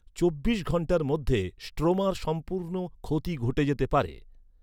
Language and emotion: Bengali, neutral